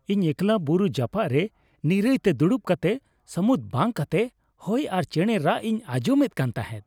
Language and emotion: Santali, happy